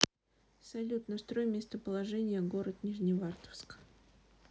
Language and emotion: Russian, neutral